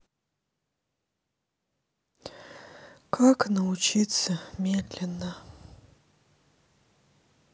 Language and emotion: Russian, sad